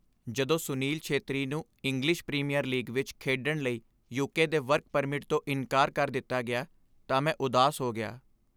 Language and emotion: Punjabi, sad